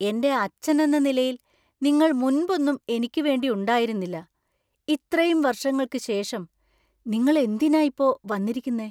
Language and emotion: Malayalam, surprised